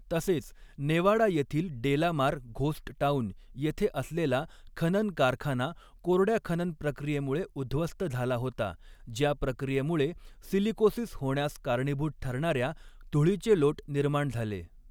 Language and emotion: Marathi, neutral